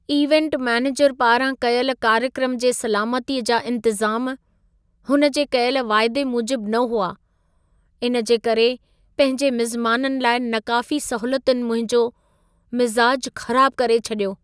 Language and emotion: Sindhi, sad